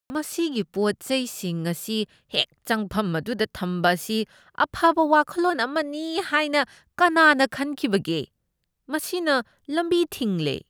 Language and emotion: Manipuri, disgusted